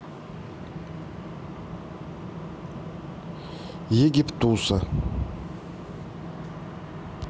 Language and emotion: Russian, neutral